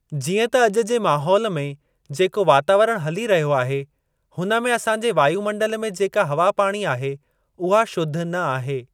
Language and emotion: Sindhi, neutral